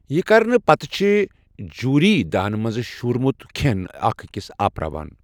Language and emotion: Kashmiri, neutral